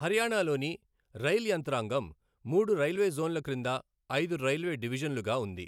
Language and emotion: Telugu, neutral